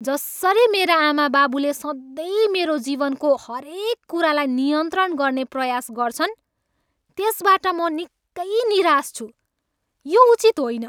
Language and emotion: Nepali, angry